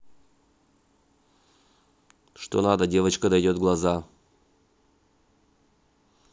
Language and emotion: Russian, neutral